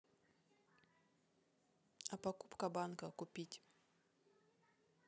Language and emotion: Russian, neutral